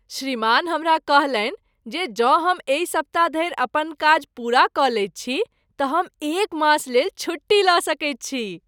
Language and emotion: Maithili, happy